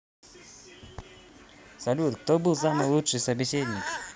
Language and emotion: Russian, positive